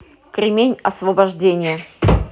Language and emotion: Russian, neutral